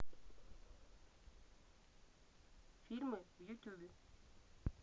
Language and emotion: Russian, neutral